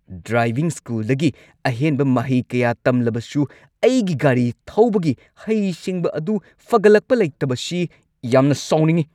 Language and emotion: Manipuri, angry